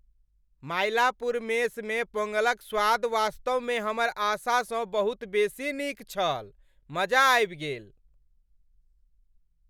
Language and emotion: Maithili, happy